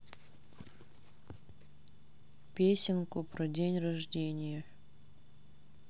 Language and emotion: Russian, neutral